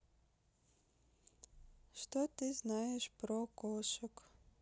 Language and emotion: Russian, neutral